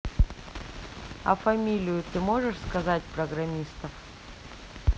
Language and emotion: Russian, neutral